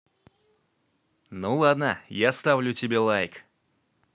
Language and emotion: Russian, positive